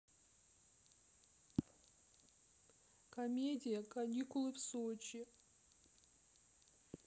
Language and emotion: Russian, sad